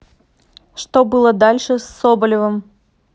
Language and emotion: Russian, neutral